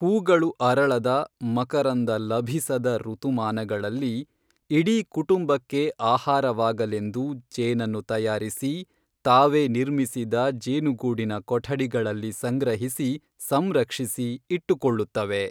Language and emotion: Kannada, neutral